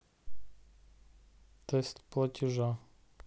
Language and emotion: Russian, neutral